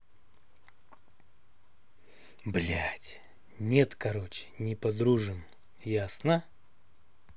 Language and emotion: Russian, angry